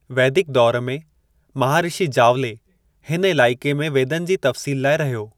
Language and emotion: Sindhi, neutral